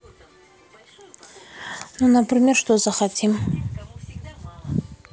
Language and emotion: Russian, neutral